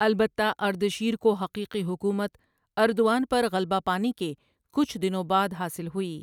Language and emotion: Urdu, neutral